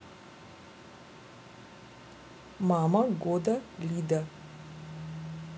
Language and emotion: Russian, neutral